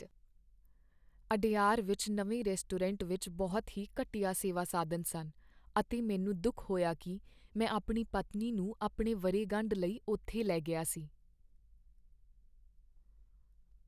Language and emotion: Punjabi, sad